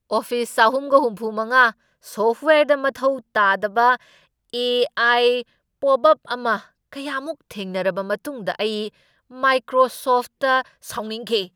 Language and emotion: Manipuri, angry